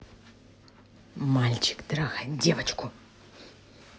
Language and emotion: Russian, angry